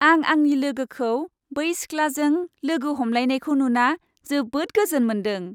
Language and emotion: Bodo, happy